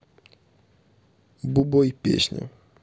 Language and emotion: Russian, neutral